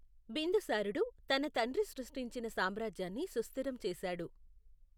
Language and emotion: Telugu, neutral